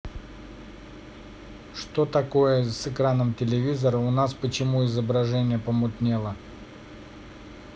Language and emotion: Russian, neutral